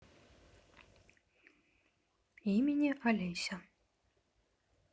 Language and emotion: Russian, neutral